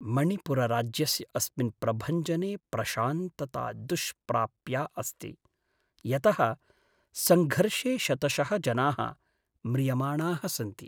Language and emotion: Sanskrit, sad